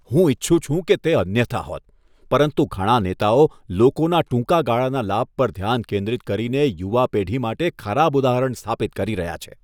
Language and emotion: Gujarati, disgusted